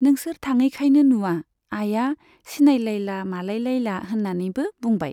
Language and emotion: Bodo, neutral